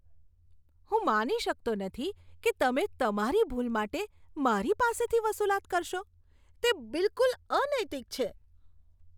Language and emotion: Gujarati, disgusted